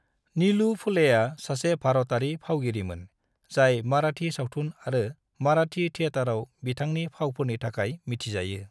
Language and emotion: Bodo, neutral